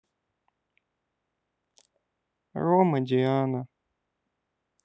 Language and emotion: Russian, sad